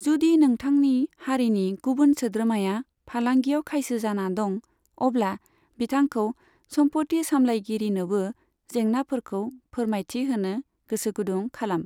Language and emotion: Bodo, neutral